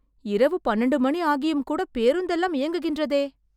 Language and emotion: Tamil, surprised